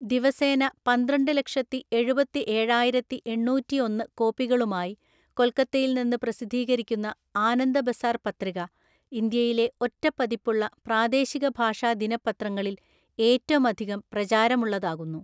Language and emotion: Malayalam, neutral